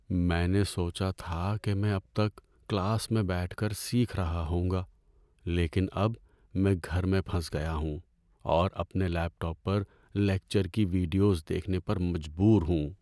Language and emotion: Urdu, sad